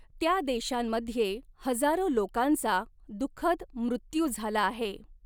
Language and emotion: Marathi, neutral